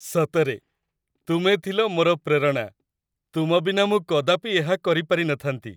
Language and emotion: Odia, happy